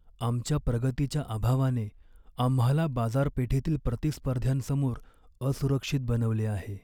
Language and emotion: Marathi, sad